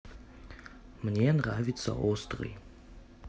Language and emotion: Russian, neutral